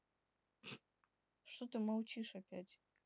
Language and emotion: Russian, neutral